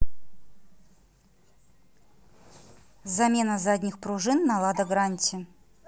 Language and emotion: Russian, neutral